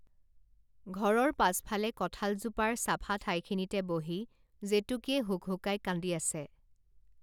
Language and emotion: Assamese, neutral